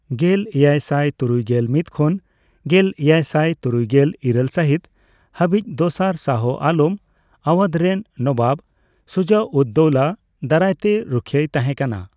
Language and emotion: Santali, neutral